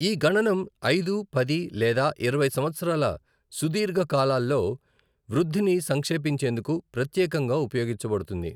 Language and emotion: Telugu, neutral